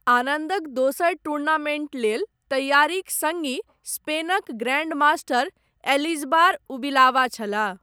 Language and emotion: Maithili, neutral